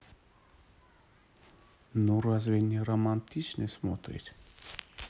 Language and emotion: Russian, neutral